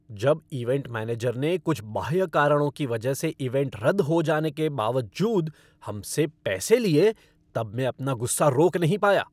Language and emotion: Hindi, angry